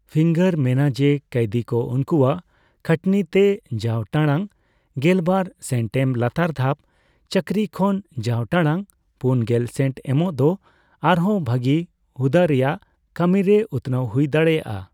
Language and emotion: Santali, neutral